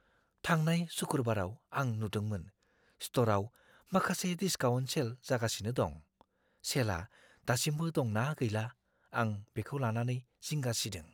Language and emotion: Bodo, fearful